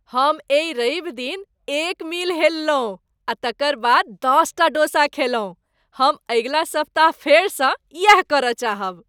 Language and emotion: Maithili, happy